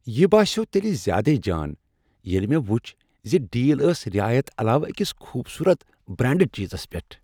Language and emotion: Kashmiri, happy